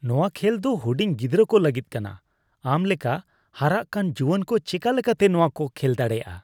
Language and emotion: Santali, disgusted